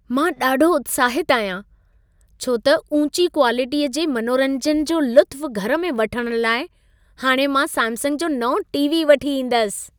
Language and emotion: Sindhi, happy